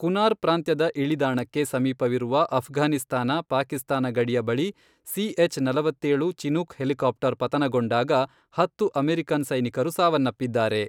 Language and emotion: Kannada, neutral